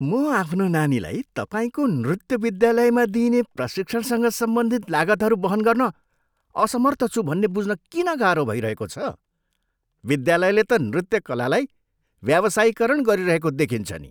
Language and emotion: Nepali, disgusted